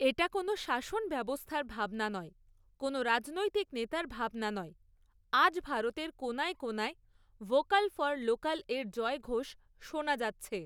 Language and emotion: Bengali, neutral